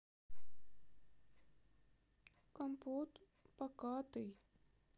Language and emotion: Russian, sad